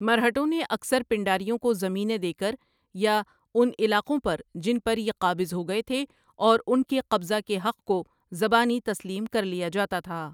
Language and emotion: Urdu, neutral